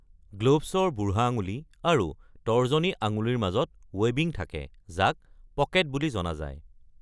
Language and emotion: Assamese, neutral